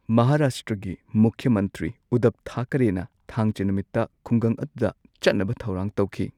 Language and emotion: Manipuri, neutral